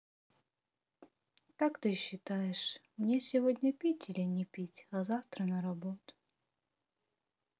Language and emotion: Russian, sad